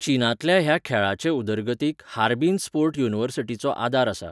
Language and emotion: Goan Konkani, neutral